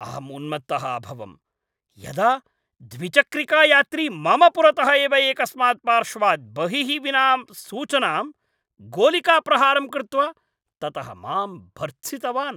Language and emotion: Sanskrit, angry